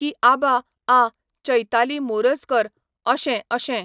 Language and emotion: Goan Konkani, neutral